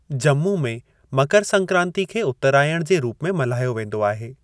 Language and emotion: Sindhi, neutral